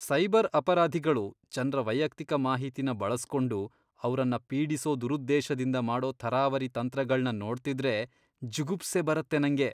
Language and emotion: Kannada, disgusted